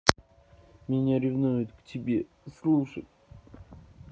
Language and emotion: Russian, sad